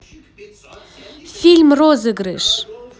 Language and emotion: Russian, positive